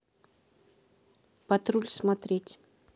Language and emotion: Russian, neutral